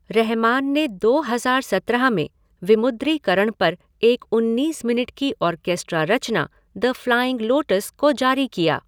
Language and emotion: Hindi, neutral